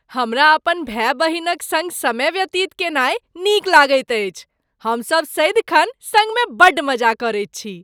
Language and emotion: Maithili, happy